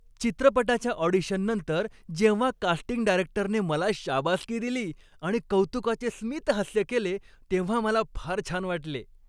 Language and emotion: Marathi, happy